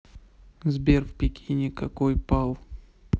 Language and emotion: Russian, neutral